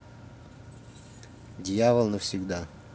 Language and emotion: Russian, neutral